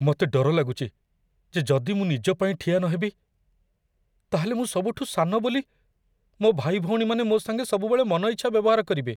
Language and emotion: Odia, fearful